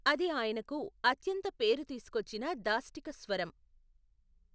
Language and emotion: Telugu, neutral